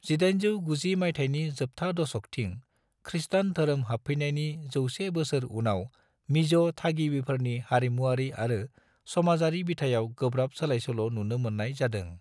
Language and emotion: Bodo, neutral